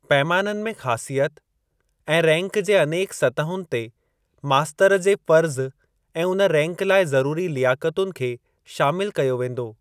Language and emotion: Sindhi, neutral